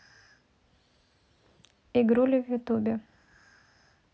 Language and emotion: Russian, neutral